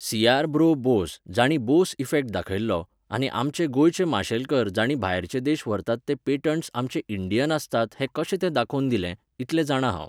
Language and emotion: Goan Konkani, neutral